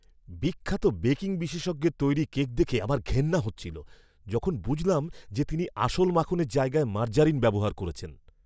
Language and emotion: Bengali, disgusted